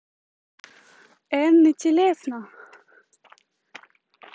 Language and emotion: Russian, neutral